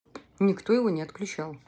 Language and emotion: Russian, neutral